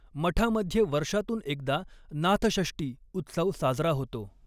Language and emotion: Marathi, neutral